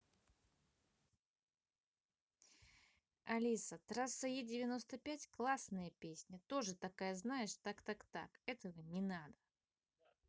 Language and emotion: Russian, positive